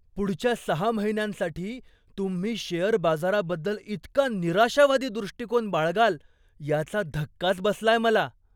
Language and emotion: Marathi, surprised